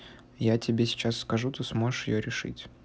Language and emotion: Russian, neutral